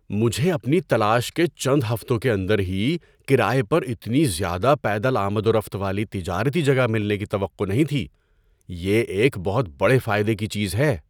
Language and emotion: Urdu, surprised